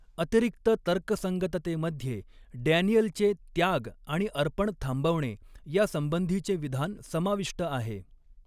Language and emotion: Marathi, neutral